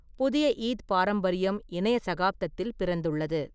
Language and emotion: Tamil, neutral